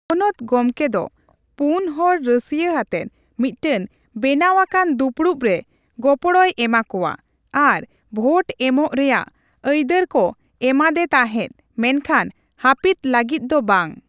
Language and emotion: Santali, neutral